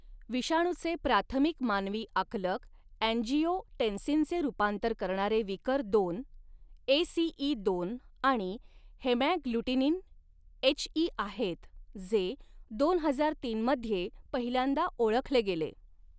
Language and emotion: Marathi, neutral